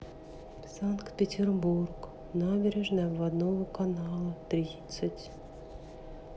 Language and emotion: Russian, sad